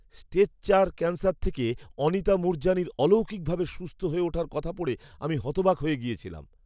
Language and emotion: Bengali, surprised